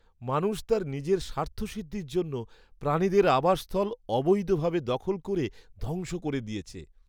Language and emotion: Bengali, sad